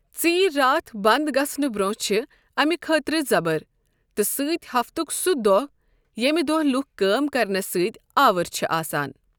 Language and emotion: Kashmiri, neutral